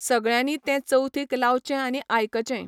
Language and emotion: Goan Konkani, neutral